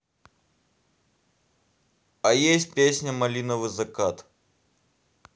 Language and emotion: Russian, neutral